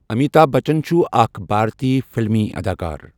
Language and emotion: Kashmiri, neutral